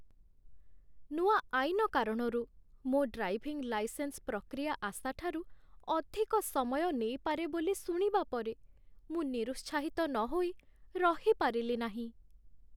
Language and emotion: Odia, sad